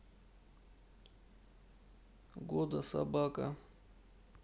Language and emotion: Russian, sad